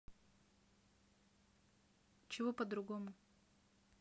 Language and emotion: Russian, neutral